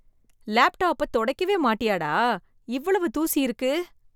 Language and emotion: Tamil, disgusted